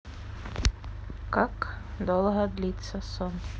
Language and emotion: Russian, neutral